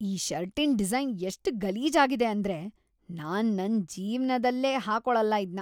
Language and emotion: Kannada, disgusted